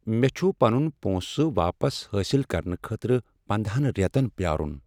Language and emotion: Kashmiri, sad